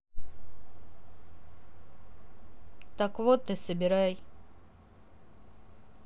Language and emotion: Russian, neutral